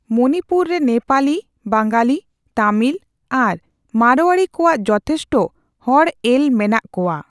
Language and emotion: Santali, neutral